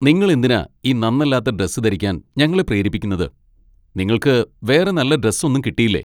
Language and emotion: Malayalam, angry